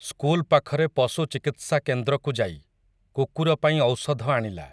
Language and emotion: Odia, neutral